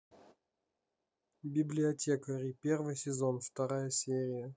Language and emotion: Russian, neutral